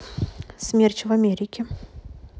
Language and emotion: Russian, neutral